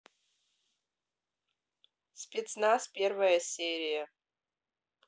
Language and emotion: Russian, neutral